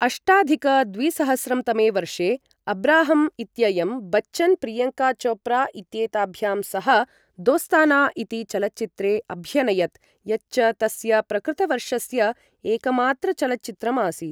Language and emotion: Sanskrit, neutral